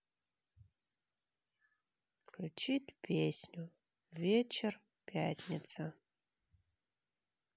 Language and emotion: Russian, sad